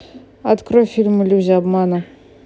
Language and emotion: Russian, neutral